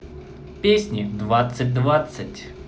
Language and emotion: Russian, positive